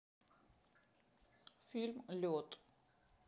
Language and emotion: Russian, neutral